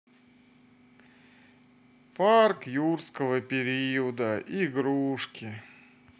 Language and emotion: Russian, sad